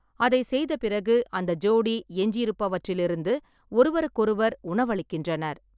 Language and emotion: Tamil, neutral